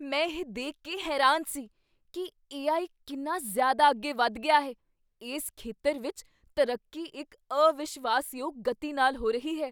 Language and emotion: Punjabi, surprised